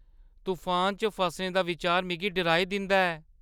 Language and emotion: Dogri, fearful